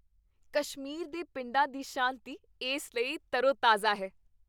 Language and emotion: Punjabi, happy